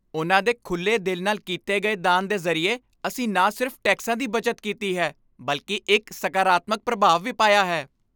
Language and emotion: Punjabi, happy